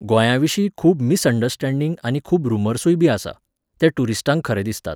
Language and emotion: Goan Konkani, neutral